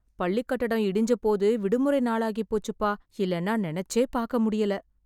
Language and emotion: Tamil, fearful